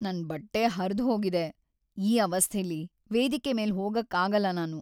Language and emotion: Kannada, sad